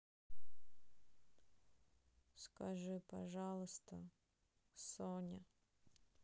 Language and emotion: Russian, sad